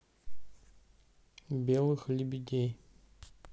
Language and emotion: Russian, neutral